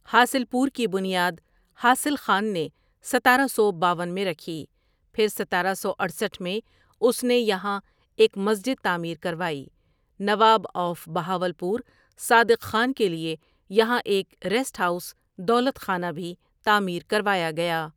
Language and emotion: Urdu, neutral